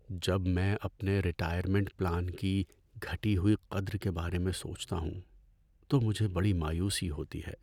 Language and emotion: Urdu, sad